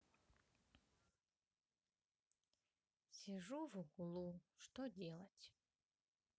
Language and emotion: Russian, neutral